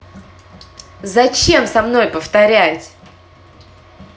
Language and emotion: Russian, angry